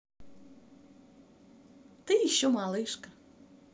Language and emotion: Russian, positive